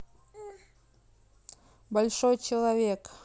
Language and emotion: Russian, neutral